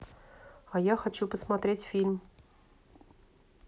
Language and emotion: Russian, neutral